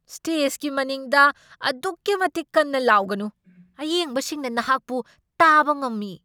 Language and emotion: Manipuri, angry